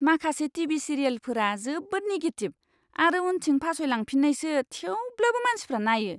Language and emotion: Bodo, disgusted